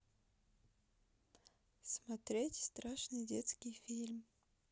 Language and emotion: Russian, neutral